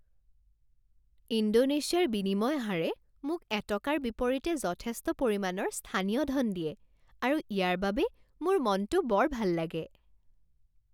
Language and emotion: Assamese, happy